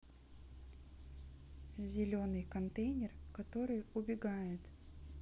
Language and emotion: Russian, neutral